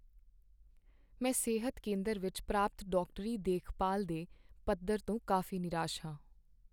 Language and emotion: Punjabi, sad